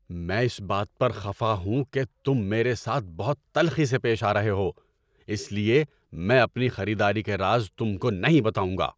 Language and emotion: Urdu, angry